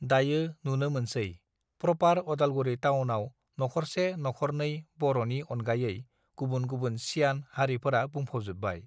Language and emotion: Bodo, neutral